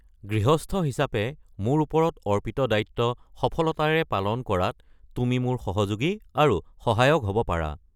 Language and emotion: Assamese, neutral